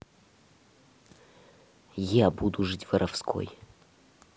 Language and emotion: Russian, angry